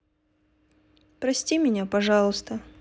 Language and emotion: Russian, sad